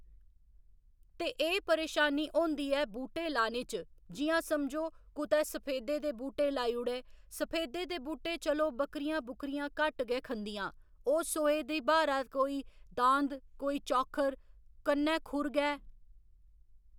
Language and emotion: Dogri, neutral